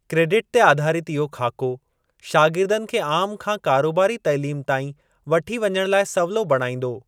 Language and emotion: Sindhi, neutral